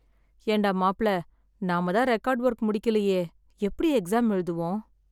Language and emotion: Tamil, sad